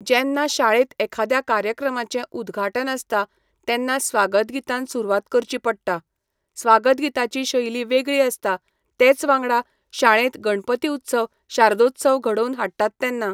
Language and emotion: Goan Konkani, neutral